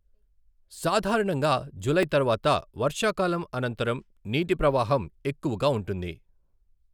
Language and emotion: Telugu, neutral